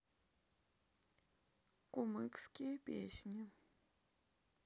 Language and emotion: Russian, neutral